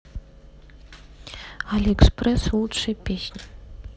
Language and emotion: Russian, neutral